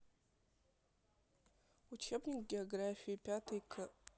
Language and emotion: Russian, neutral